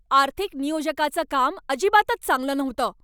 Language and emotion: Marathi, angry